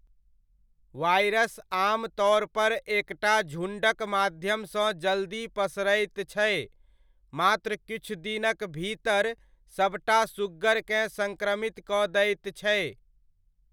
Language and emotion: Maithili, neutral